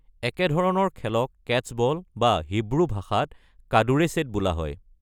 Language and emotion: Assamese, neutral